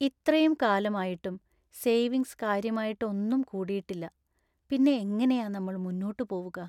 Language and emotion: Malayalam, sad